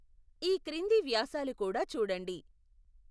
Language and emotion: Telugu, neutral